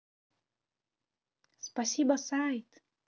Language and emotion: Russian, positive